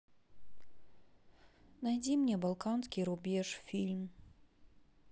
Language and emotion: Russian, sad